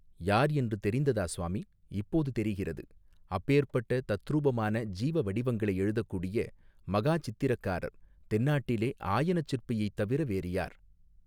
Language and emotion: Tamil, neutral